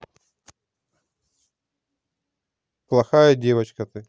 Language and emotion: Russian, neutral